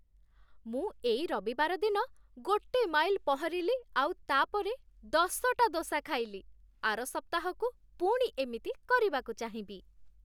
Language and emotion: Odia, happy